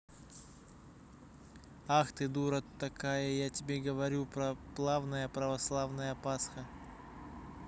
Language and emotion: Russian, neutral